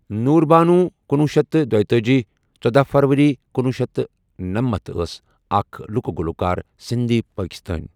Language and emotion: Kashmiri, neutral